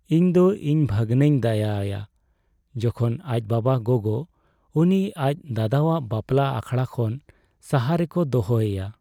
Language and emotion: Santali, sad